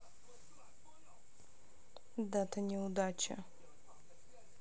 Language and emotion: Russian, sad